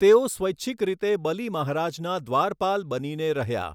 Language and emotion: Gujarati, neutral